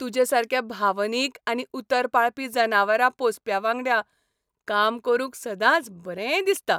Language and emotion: Goan Konkani, happy